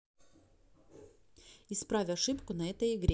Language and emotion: Russian, neutral